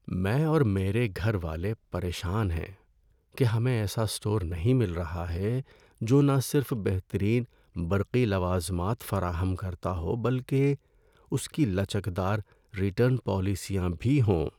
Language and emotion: Urdu, sad